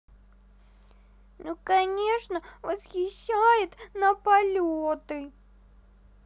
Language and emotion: Russian, sad